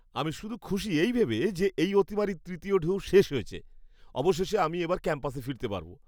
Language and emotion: Bengali, happy